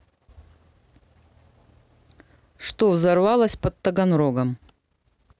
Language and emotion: Russian, neutral